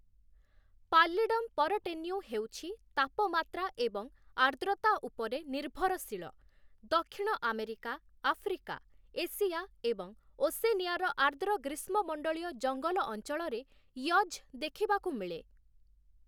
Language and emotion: Odia, neutral